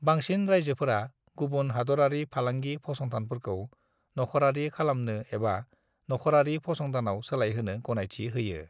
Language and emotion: Bodo, neutral